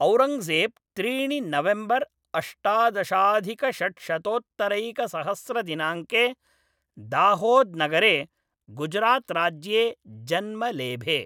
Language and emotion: Sanskrit, neutral